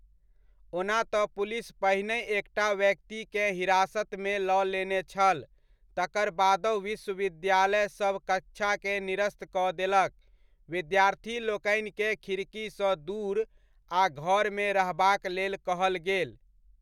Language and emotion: Maithili, neutral